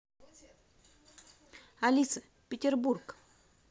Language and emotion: Russian, positive